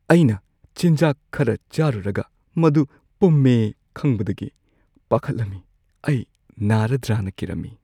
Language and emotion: Manipuri, fearful